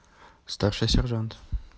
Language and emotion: Russian, neutral